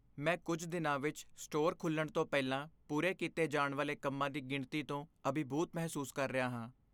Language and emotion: Punjabi, fearful